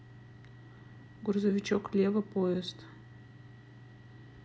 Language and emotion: Russian, neutral